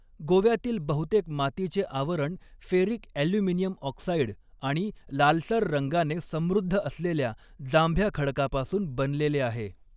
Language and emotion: Marathi, neutral